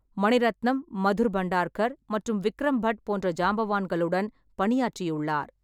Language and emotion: Tamil, neutral